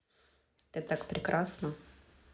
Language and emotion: Russian, neutral